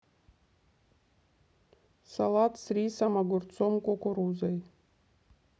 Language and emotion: Russian, neutral